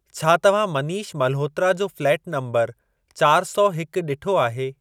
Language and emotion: Sindhi, neutral